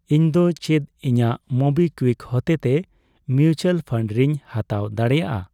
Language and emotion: Santali, neutral